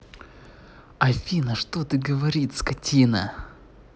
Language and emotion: Russian, angry